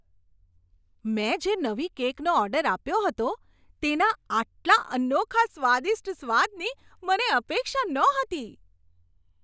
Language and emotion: Gujarati, surprised